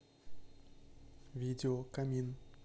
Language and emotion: Russian, neutral